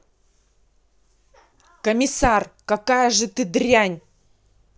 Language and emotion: Russian, angry